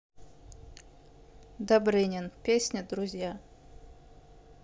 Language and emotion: Russian, neutral